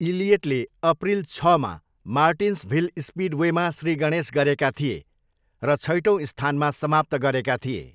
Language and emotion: Nepali, neutral